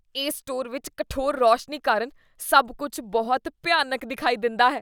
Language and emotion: Punjabi, disgusted